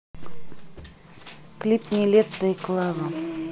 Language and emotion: Russian, neutral